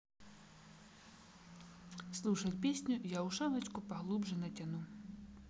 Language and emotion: Russian, neutral